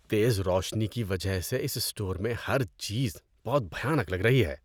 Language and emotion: Urdu, disgusted